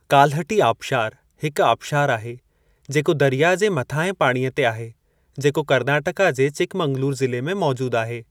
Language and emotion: Sindhi, neutral